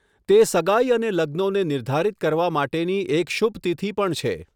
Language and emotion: Gujarati, neutral